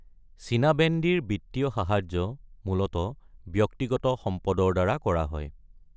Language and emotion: Assamese, neutral